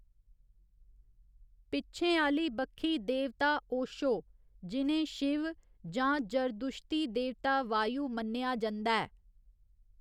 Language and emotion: Dogri, neutral